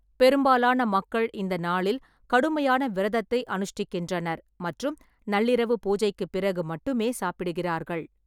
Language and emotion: Tamil, neutral